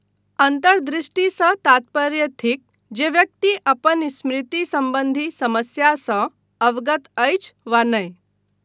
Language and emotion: Maithili, neutral